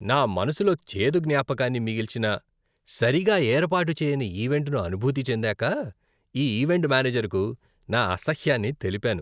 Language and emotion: Telugu, disgusted